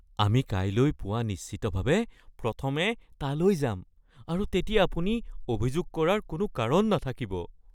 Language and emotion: Assamese, fearful